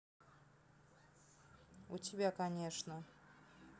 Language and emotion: Russian, neutral